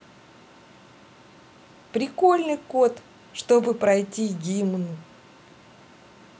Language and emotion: Russian, positive